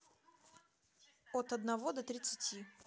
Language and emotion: Russian, neutral